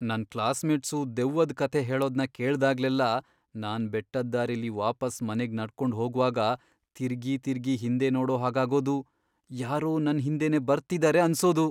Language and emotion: Kannada, fearful